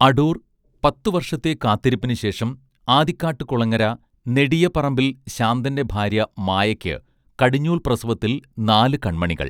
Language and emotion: Malayalam, neutral